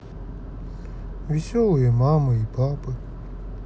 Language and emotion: Russian, sad